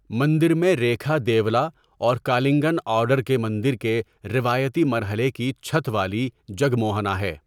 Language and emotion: Urdu, neutral